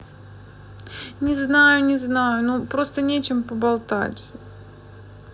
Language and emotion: Russian, sad